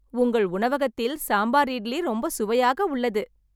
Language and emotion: Tamil, happy